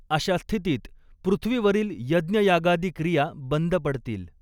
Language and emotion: Marathi, neutral